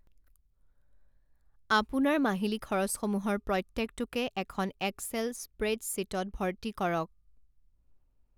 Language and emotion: Assamese, neutral